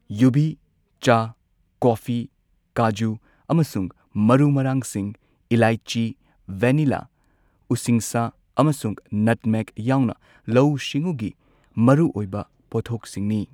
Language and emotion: Manipuri, neutral